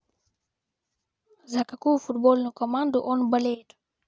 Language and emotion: Russian, neutral